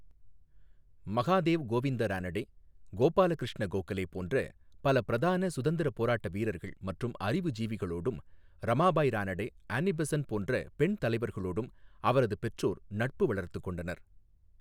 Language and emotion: Tamil, neutral